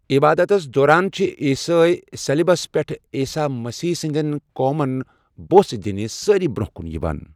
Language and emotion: Kashmiri, neutral